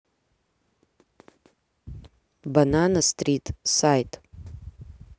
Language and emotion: Russian, neutral